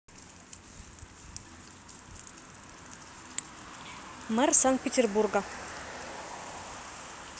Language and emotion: Russian, neutral